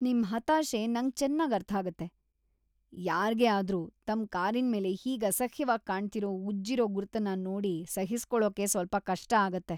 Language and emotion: Kannada, disgusted